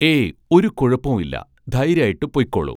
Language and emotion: Malayalam, neutral